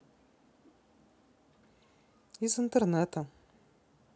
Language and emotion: Russian, neutral